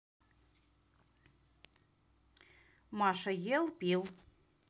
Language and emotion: Russian, neutral